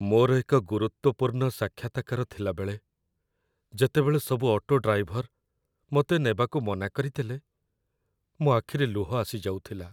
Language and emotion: Odia, sad